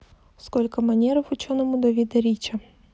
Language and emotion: Russian, neutral